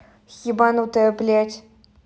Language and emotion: Russian, angry